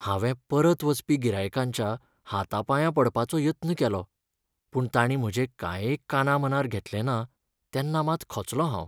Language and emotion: Goan Konkani, sad